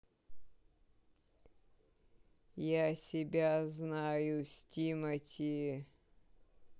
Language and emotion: Russian, neutral